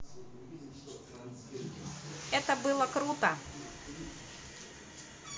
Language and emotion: Russian, positive